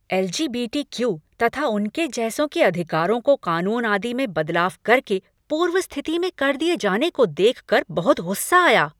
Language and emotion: Hindi, angry